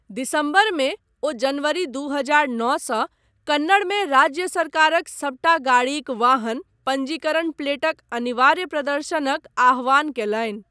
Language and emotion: Maithili, neutral